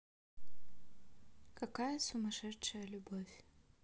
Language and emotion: Russian, neutral